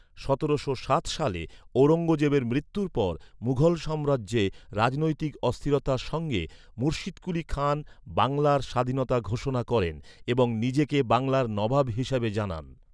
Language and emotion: Bengali, neutral